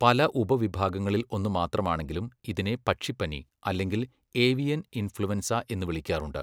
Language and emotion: Malayalam, neutral